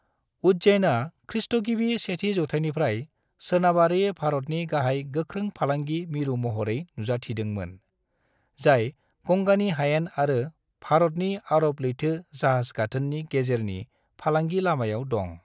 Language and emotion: Bodo, neutral